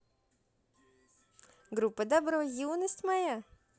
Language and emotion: Russian, positive